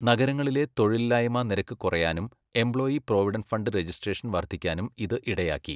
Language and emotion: Malayalam, neutral